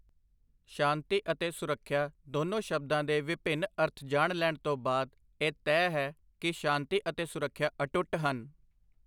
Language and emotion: Punjabi, neutral